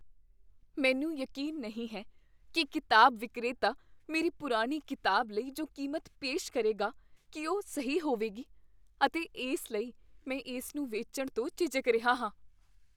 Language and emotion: Punjabi, fearful